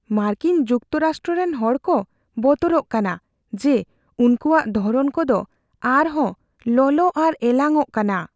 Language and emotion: Santali, fearful